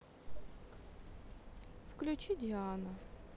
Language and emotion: Russian, neutral